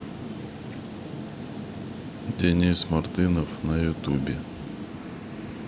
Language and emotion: Russian, neutral